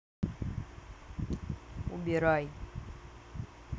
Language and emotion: Russian, neutral